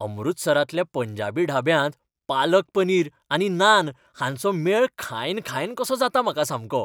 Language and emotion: Goan Konkani, happy